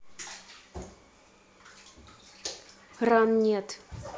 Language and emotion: Russian, angry